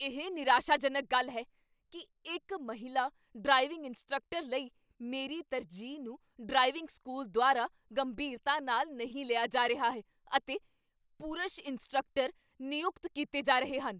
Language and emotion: Punjabi, angry